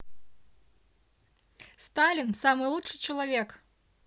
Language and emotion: Russian, positive